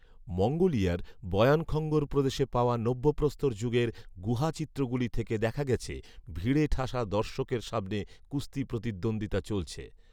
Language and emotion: Bengali, neutral